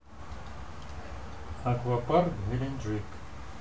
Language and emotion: Russian, neutral